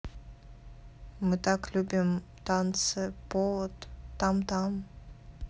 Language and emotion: Russian, neutral